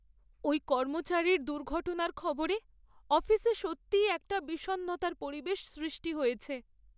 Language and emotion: Bengali, sad